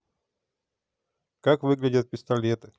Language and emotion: Russian, neutral